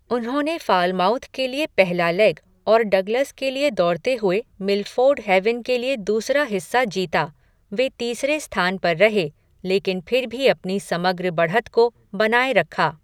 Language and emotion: Hindi, neutral